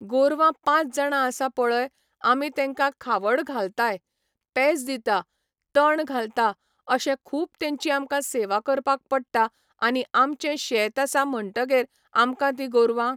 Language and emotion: Goan Konkani, neutral